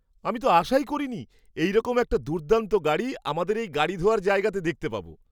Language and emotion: Bengali, surprised